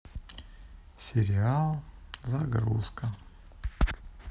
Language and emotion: Russian, neutral